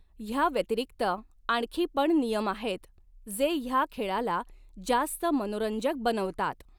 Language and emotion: Marathi, neutral